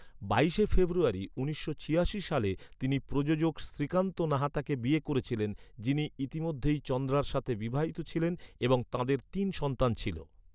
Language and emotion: Bengali, neutral